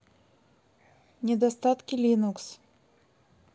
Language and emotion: Russian, neutral